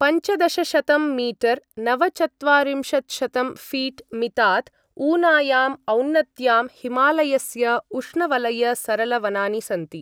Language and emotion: Sanskrit, neutral